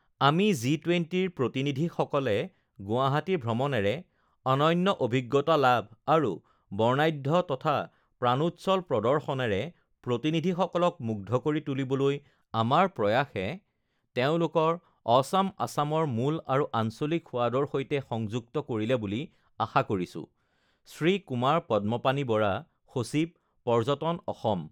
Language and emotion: Assamese, neutral